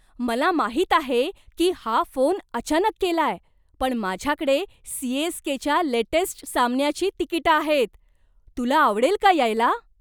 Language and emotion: Marathi, surprised